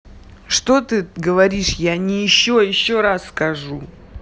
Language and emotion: Russian, angry